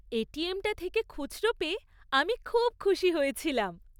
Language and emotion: Bengali, happy